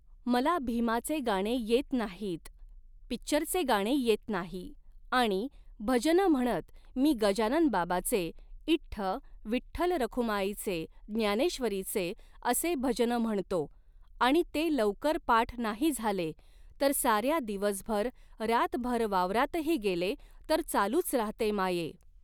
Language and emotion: Marathi, neutral